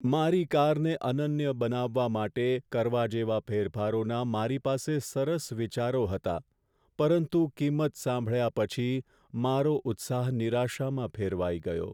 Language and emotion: Gujarati, sad